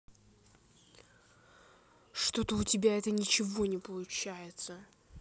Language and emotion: Russian, angry